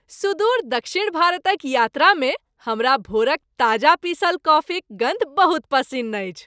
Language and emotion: Maithili, happy